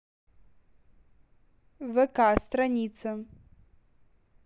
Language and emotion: Russian, neutral